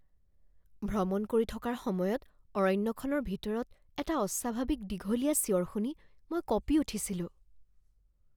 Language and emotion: Assamese, fearful